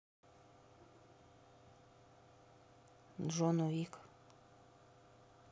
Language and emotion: Russian, neutral